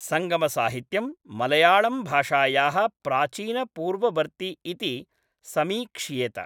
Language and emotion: Sanskrit, neutral